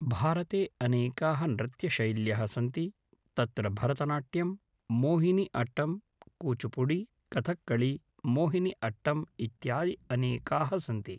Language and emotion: Sanskrit, neutral